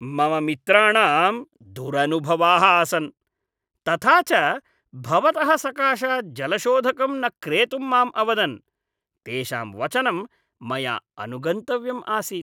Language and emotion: Sanskrit, disgusted